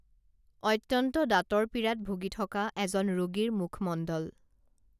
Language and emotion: Assamese, neutral